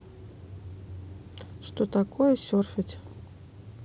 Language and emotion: Russian, neutral